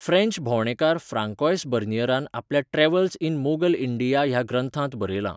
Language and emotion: Goan Konkani, neutral